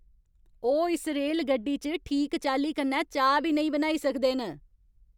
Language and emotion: Dogri, angry